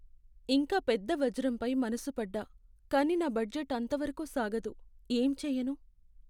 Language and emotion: Telugu, sad